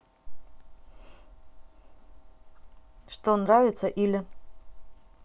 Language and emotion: Russian, neutral